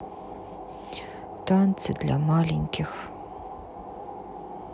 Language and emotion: Russian, sad